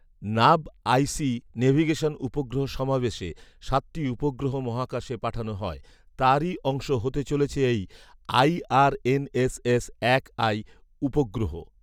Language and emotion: Bengali, neutral